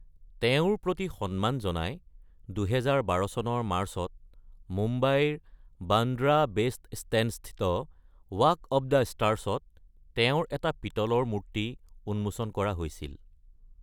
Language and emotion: Assamese, neutral